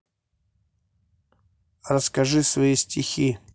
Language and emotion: Russian, neutral